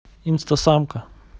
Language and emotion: Russian, neutral